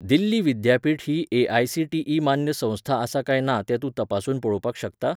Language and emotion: Goan Konkani, neutral